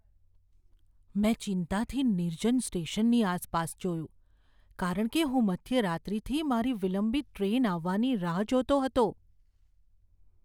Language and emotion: Gujarati, fearful